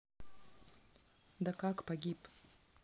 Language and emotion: Russian, neutral